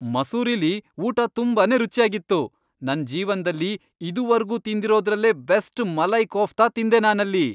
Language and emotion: Kannada, happy